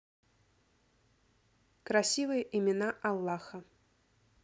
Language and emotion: Russian, neutral